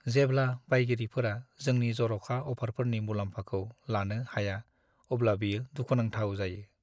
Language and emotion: Bodo, sad